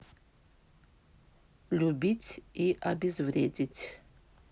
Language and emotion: Russian, neutral